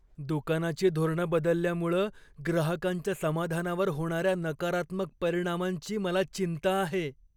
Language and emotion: Marathi, fearful